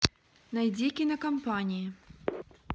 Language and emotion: Russian, neutral